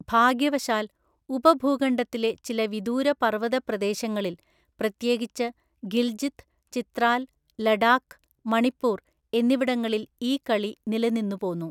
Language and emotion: Malayalam, neutral